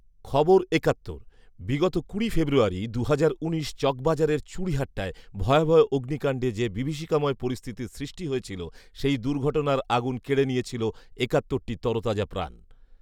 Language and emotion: Bengali, neutral